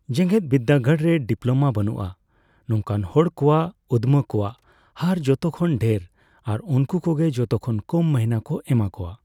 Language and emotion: Santali, neutral